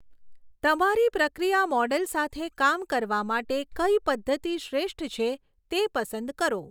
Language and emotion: Gujarati, neutral